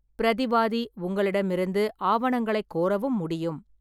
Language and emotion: Tamil, neutral